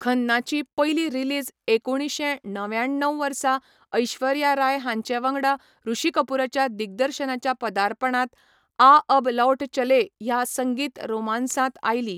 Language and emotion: Goan Konkani, neutral